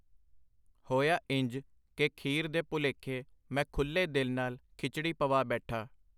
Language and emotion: Punjabi, neutral